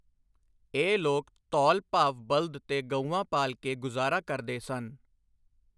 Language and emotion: Punjabi, neutral